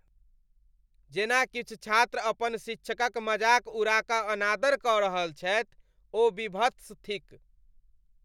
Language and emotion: Maithili, disgusted